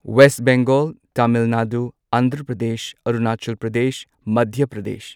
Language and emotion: Manipuri, neutral